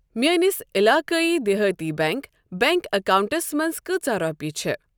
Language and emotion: Kashmiri, neutral